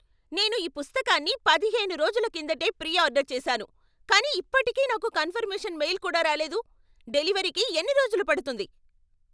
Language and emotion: Telugu, angry